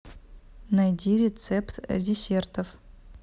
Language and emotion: Russian, neutral